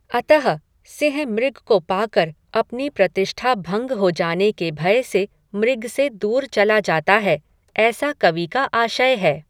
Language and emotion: Hindi, neutral